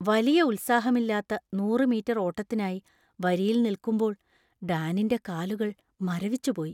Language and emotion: Malayalam, fearful